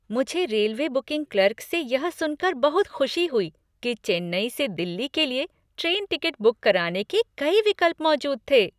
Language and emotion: Hindi, happy